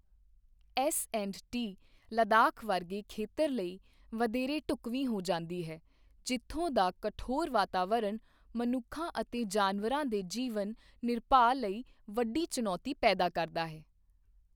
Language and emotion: Punjabi, neutral